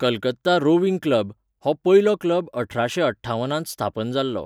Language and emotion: Goan Konkani, neutral